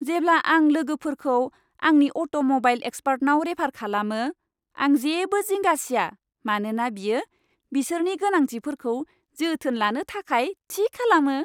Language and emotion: Bodo, happy